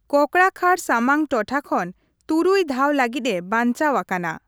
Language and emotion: Santali, neutral